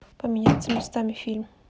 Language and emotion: Russian, neutral